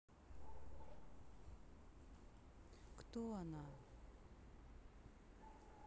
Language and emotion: Russian, neutral